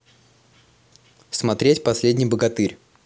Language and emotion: Russian, positive